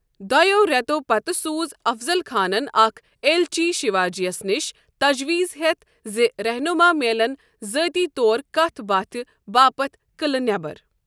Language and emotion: Kashmiri, neutral